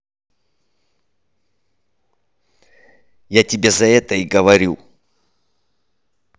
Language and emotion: Russian, angry